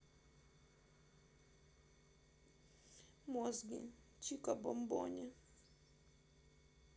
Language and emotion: Russian, sad